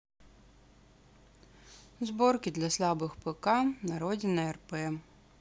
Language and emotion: Russian, neutral